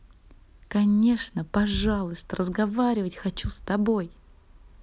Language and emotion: Russian, positive